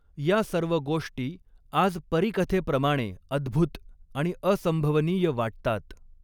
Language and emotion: Marathi, neutral